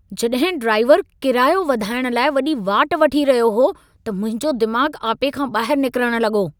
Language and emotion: Sindhi, angry